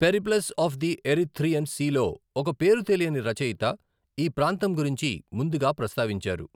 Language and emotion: Telugu, neutral